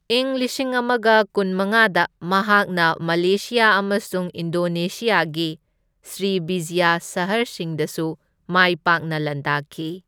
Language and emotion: Manipuri, neutral